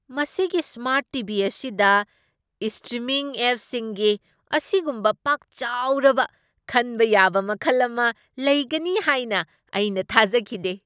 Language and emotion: Manipuri, surprised